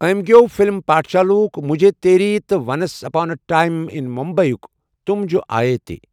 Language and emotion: Kashmiri, neutral